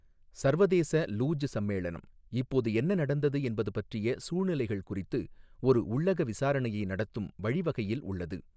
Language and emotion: Tamil, neutral